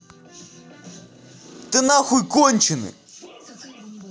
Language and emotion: Russian, angry